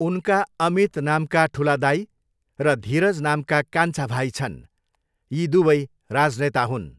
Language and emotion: Nepali, neutral